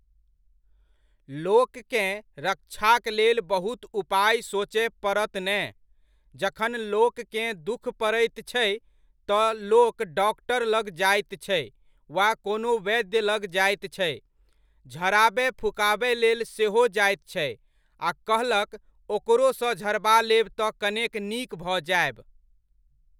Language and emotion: Maithili, neutral